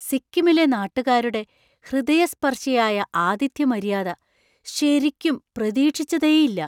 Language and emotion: Malayalam, surprised